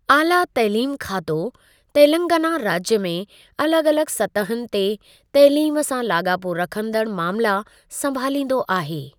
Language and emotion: Sindhi, neutral